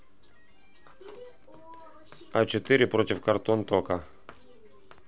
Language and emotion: Russian, neutral